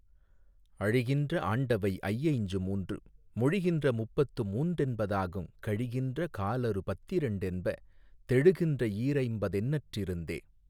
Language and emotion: Tamil, neutral